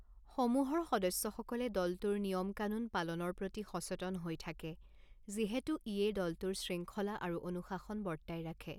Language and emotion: Assamese, neutral